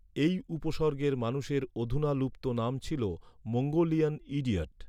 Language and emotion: Bengali, neutral